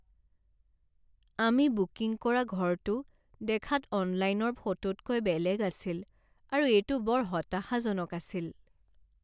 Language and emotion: Assamese, sad